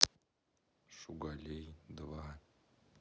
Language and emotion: Russian, neutral